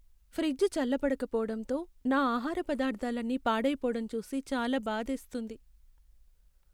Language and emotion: Telugu, sad